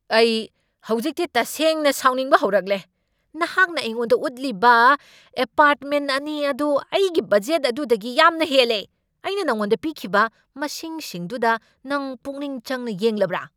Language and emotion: Manipuri, angry